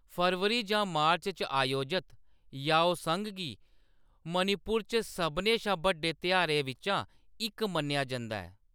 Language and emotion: Dogri, neutral